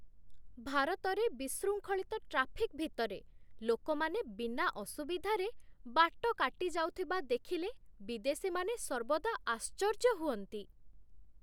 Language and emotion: Odia, surprised